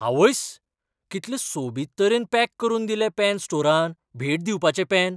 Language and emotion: Goan Konkani, surprised